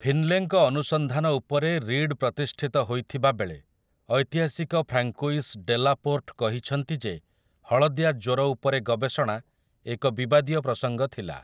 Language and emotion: Odia, neutral